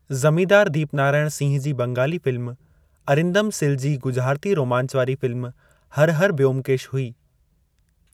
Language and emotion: Sindhi, neutral